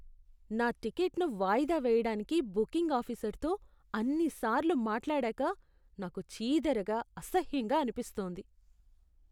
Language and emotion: Telugu, disgusted